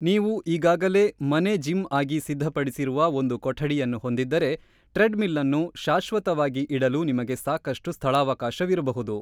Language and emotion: Kannada, neutral